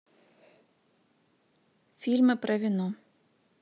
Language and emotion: Russian, neutral